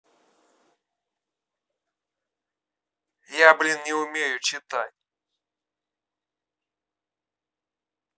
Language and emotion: Russian, angry